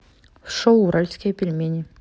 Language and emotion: Russian, neutral